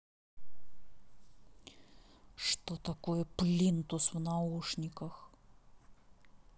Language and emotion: Russian, angry